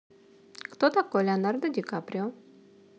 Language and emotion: Russian, neutral